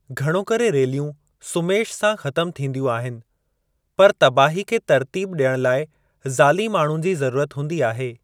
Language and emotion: Sindhi, neutral